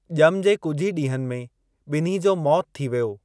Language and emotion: Sindhi, neutral